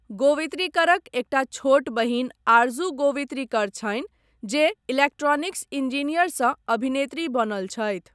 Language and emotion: Maithili, neutral